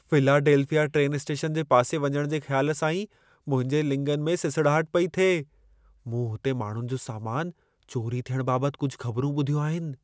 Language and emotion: Sindhi, fearful